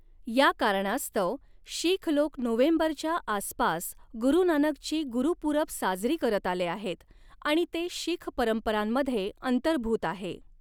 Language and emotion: Marathi, neutral